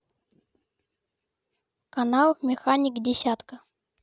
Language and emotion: Russian, neutral